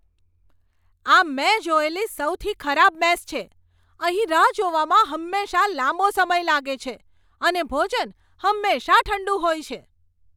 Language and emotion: Gujarati, angry